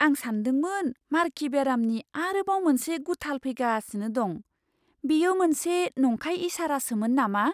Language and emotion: Bodo, surprised